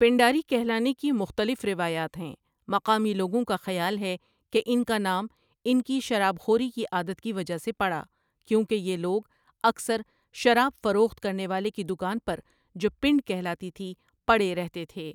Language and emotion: Urdu, neutral